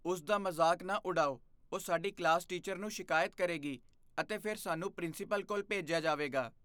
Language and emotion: Punjabi, fearful